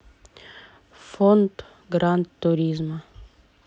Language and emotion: Russian, neutral